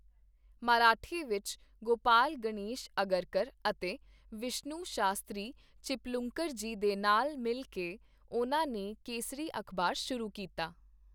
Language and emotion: Punjabi, neutral